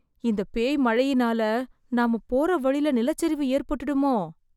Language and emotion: Tamil, fearful